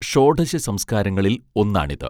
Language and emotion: Malayalam, neutral